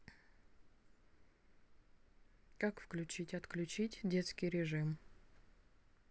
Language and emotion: Russian, neutral